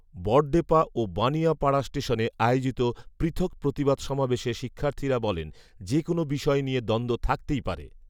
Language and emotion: Bengali, neutral